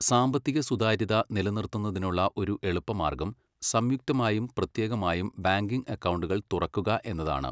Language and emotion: Malayalam, neutral